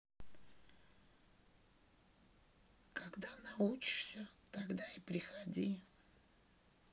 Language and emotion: Russian, sad